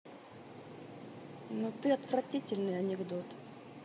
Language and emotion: Russian, neutral